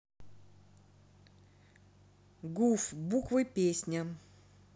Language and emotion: Russian, neutral